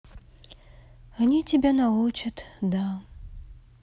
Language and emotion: Russian, sad